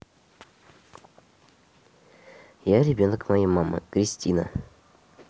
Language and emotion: Russian, neutral